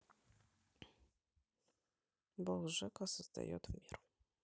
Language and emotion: Russian, neutral